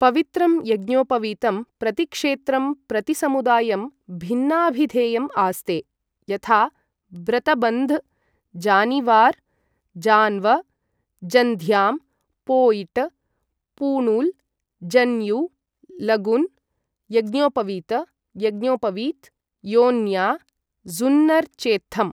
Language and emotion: Sanskrit, neutral